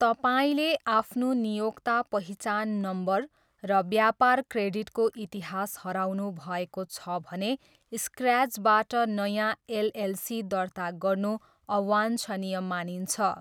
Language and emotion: Nepali, neutral